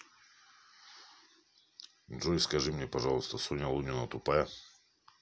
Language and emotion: Russian, neutral